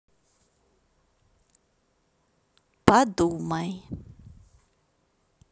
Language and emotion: Russian, neutral